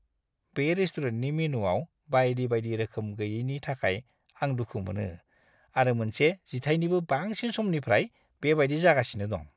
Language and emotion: Bodo, disgusted